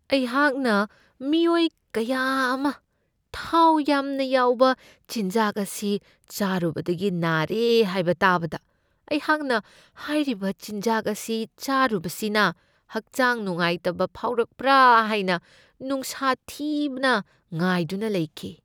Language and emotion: Manipuri, fearful